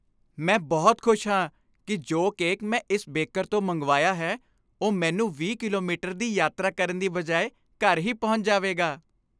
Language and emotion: Punjabi, happy